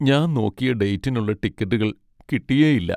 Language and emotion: Malayalam, sad